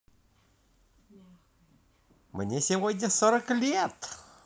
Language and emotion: Russian, positive